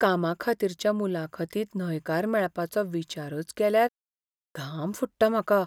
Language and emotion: Goan Konkani, fearful